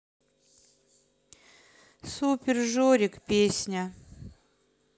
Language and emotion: Russian, sad